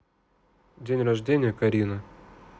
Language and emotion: Russian, neutral